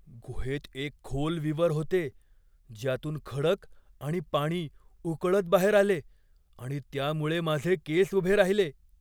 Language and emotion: Marathi, fearful